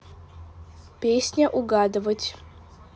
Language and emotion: Russian, neutral